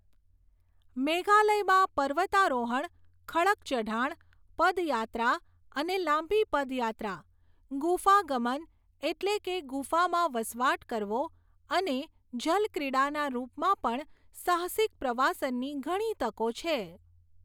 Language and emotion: Gujarati, neutral